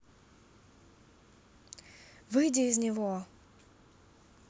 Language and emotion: Russian, angry